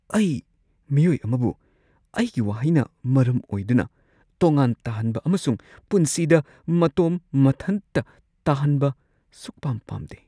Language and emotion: Manipuri, fearful